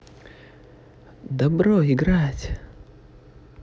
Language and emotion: Russian, positive